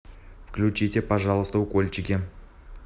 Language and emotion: Russian, neutral